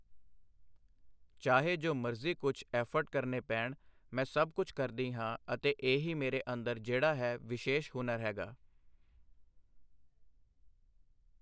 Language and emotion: Punjabi, neutral